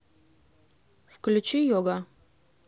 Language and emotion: Russian, neutral